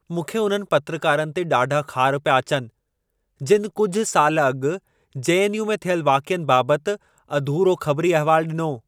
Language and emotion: Sindhi, angry